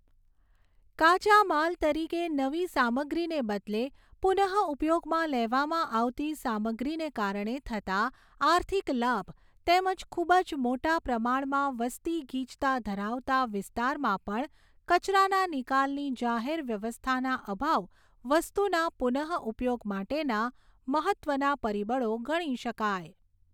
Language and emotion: Gujarati, neutral